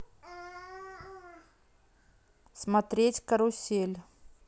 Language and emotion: Russian, neutral